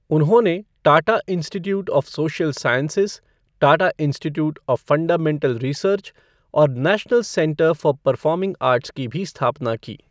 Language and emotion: Hindi, neutral